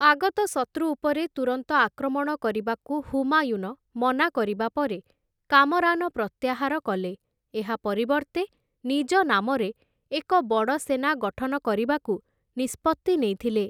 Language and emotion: Odia, neutral